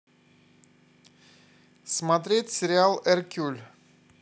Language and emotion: Russian, positive